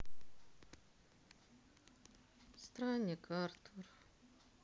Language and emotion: Russian, sad